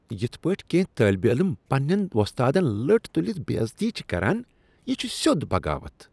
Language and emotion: Kashmiri, disgusted